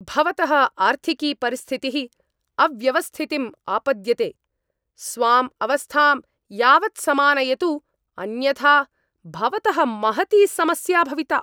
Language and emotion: Sanskrit, angry